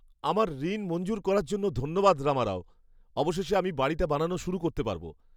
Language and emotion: Bengali, happy